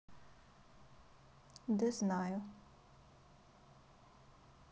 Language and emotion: Russian, sad